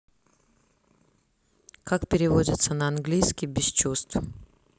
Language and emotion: Russian, neutral